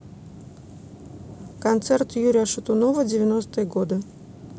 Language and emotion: Russian, neutral